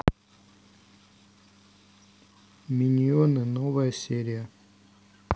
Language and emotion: Russian, neutral